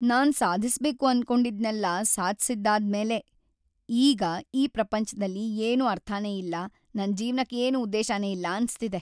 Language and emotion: Kannada, sad